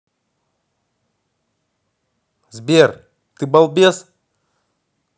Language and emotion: Russian, angry